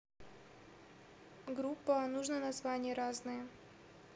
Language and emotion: Russian, neutral